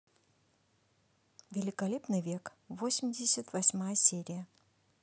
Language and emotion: Russian, neutral